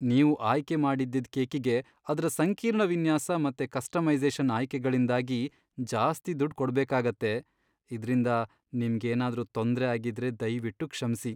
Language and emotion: Kannada, sad